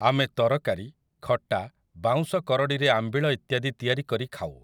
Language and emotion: Odia, neutral